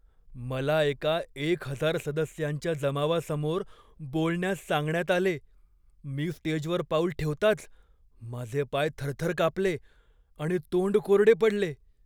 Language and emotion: Marathi, fearful